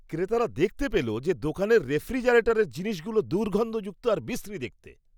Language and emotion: Bengali, disgusted